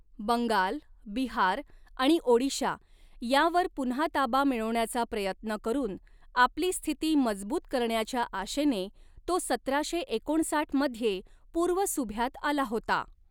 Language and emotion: Marathi, neutral